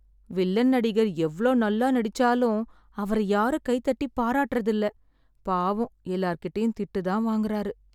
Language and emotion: Tamil, sad